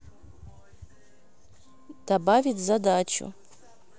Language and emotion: Russian, neutral